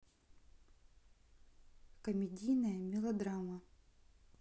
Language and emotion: Russian, neutral